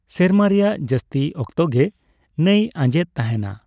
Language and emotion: Santali, neutral